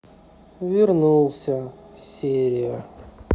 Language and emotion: Russian, sad